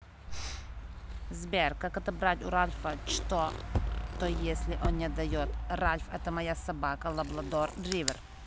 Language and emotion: Russian, neutral